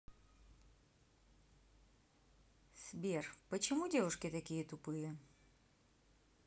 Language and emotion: Russian, neutral